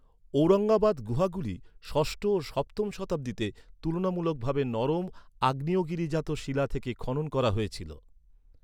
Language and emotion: Bengali, neutral